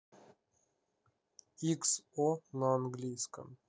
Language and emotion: Russian, neutral